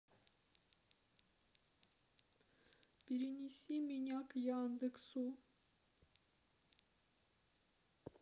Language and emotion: Russian, sad